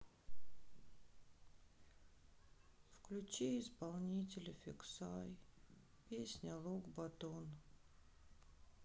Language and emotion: Russian, sad